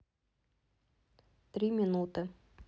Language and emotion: Russian, neutral